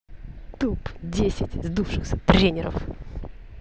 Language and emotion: Russian, angry